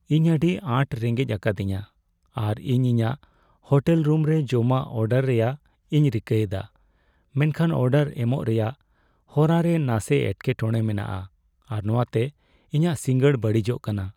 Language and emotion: Santali, sad